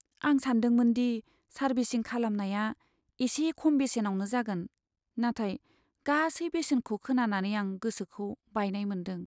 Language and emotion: Bodo, sad